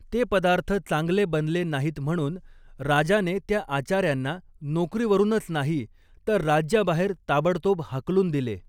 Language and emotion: Marathi, neutral